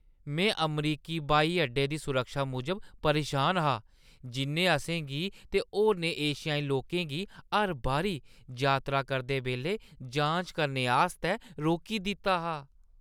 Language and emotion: Dogri, disgusted